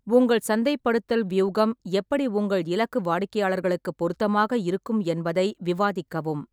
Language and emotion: Tamil, neutral